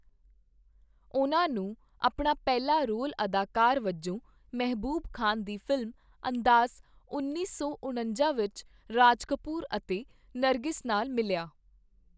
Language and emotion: Punjabi, neutral